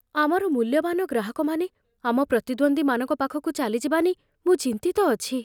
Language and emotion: Odia, fearful